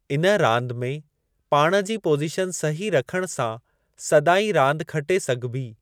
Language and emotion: Sindhi, neutral